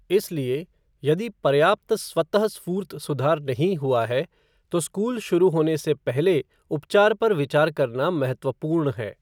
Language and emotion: Hindi, neutral